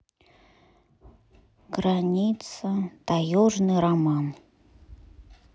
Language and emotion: Russian, sad